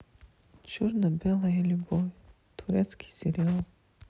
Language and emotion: Russian, sad